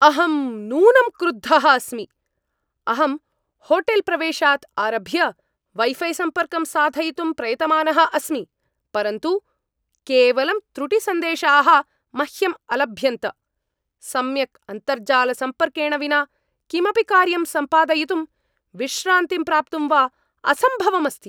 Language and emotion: Sanskrit, angry